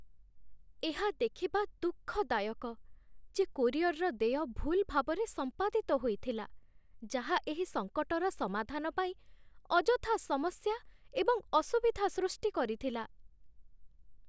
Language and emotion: Odia, sad